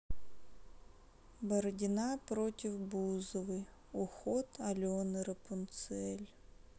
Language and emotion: Russian, sad